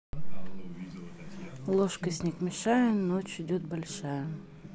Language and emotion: Russian, neutral